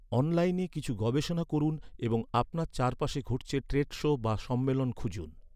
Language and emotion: Bengali, neutral